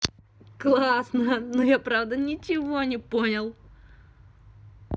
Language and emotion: Russian, positive